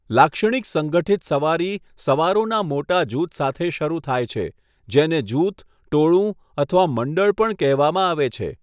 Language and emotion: Gujarati, neutral